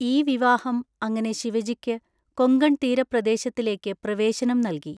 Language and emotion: Malayalam, neutral